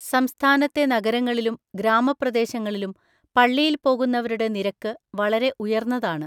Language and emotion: Malayalam, neutral